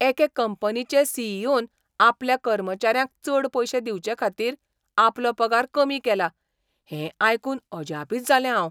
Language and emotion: Goan Konkani, surprised